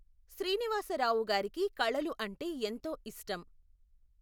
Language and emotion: Telugu, neutral